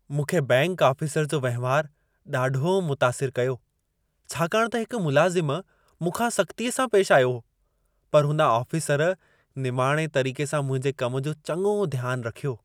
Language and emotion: Sindhi, happy